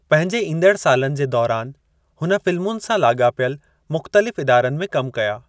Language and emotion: Sindhi, neutral